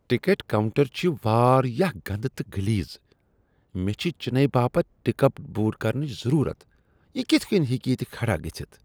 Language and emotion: Kashmiri, disgusted